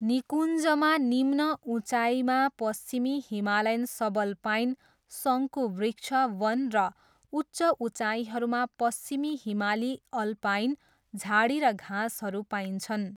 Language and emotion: Nepali, neutral